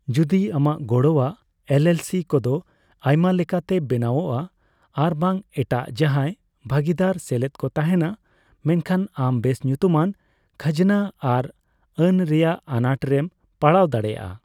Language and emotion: Santali, neutral